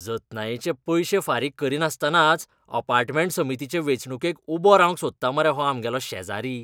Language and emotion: Goan Konkani, disgusted